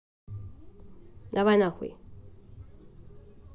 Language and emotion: Russian, angry